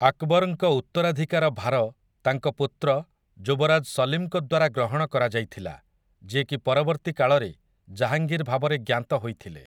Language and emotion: Odia, neutral